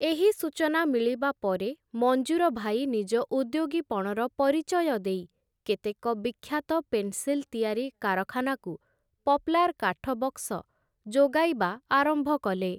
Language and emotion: Odia, neutral